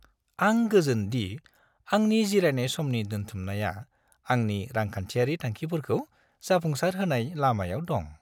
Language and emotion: Bodo, happy